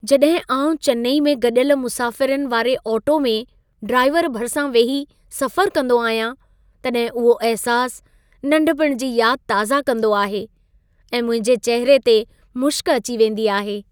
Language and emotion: Sindhi, happy